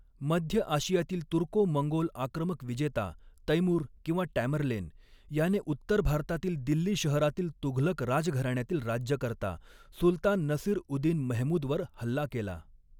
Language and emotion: Marathi, neutral